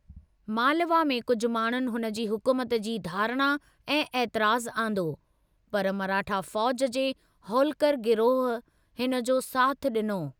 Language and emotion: Sindhi, neutral